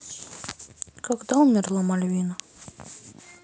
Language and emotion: Russian, sad